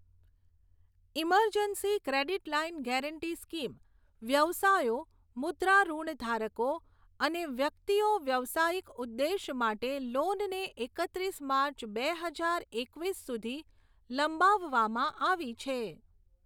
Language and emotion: Gujarati, neutral